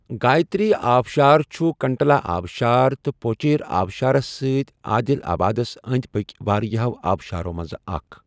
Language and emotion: Kashmiri, neutral